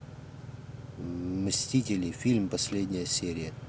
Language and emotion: Russian, neutral